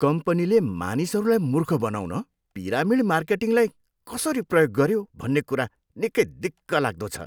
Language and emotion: Nepali, disgusted